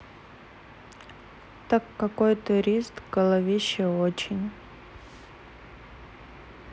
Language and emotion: Russian, sad